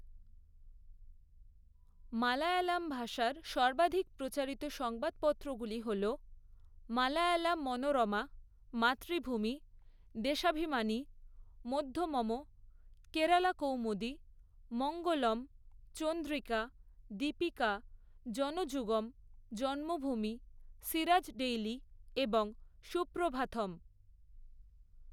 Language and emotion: Bengali, neutral